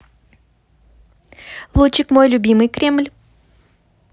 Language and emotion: Russian, positive